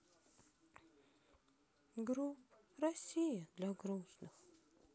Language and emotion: Russian, sad